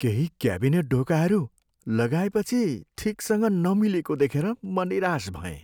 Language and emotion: Nepali, sad